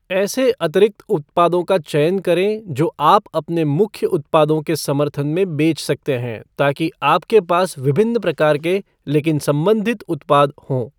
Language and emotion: Hindi, neutral